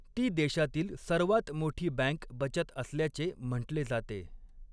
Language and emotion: Marathi, neutral